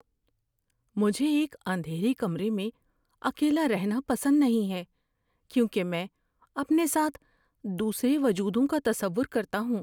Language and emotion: Urdu, fearful